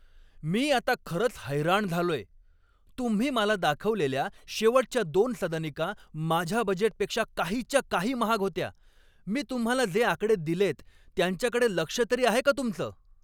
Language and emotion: Marathi, angry